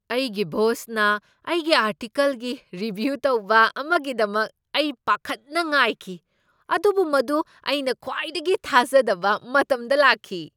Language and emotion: Manipuri, surprised